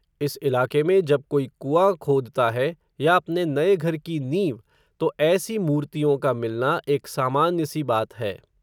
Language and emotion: Hindi, neutral